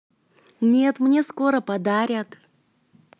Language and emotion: Russian, positive